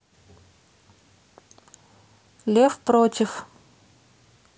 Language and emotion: Russian, neutral